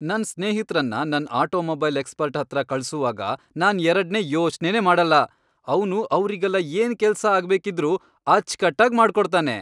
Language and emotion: Kannada, happy